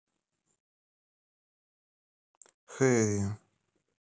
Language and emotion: Russian, neutral